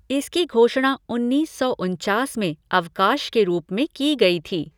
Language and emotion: Hindi, neutral